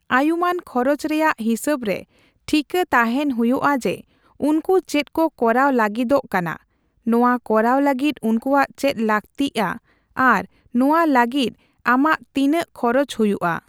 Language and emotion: Santali, neutral